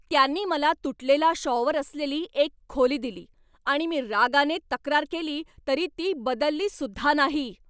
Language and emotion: Marathi, angry